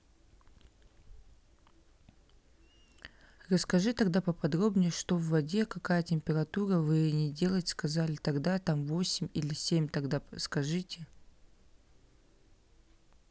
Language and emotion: Russian, neutral